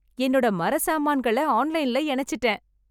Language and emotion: Tamil, happy